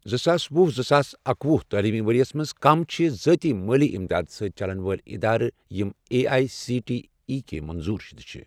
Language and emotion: Kashmiri, neutral